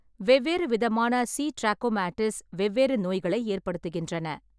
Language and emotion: Tamil, neutral